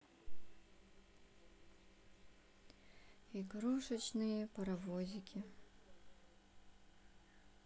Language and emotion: Russian, sad